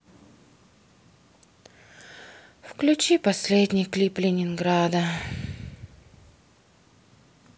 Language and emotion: Russian, sad